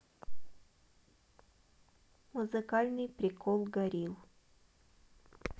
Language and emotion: Russian, neutral